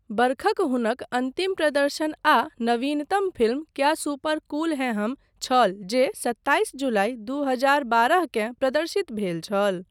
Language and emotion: Maithili, neutral